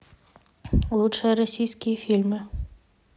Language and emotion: Russian, neutral